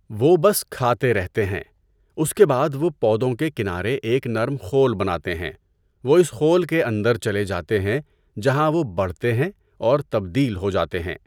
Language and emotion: Urdu, neutral